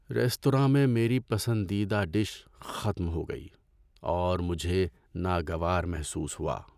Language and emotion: Urdu, sad